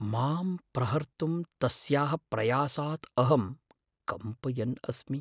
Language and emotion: Sanskrit, fearful